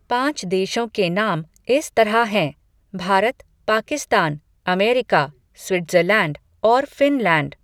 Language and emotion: Hindi, neutral